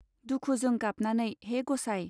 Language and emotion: Bodo, neutral